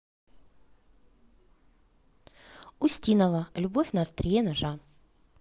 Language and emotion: Russian, neutral